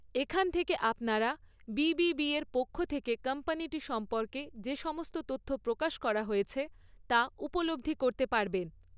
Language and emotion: Bengali, neutral